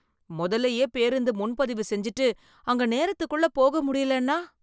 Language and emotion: Tamil, fearful